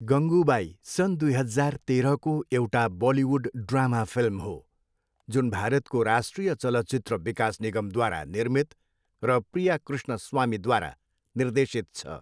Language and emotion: Nepali, neutral